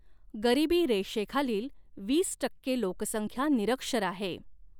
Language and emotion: Marathi, neutral